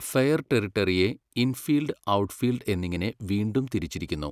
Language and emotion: Malayalam, neutral